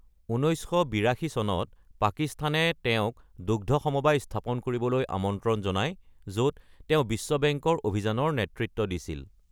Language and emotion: Assamese, neutral